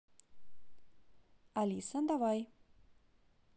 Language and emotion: Russian, positive